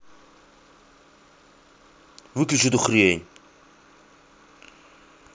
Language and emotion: Russian, angry